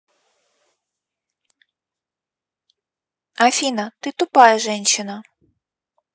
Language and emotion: Russian, neutral